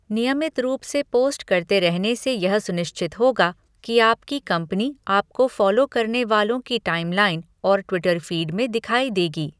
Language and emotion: Hindi, neutral